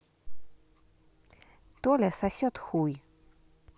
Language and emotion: Russian, neutral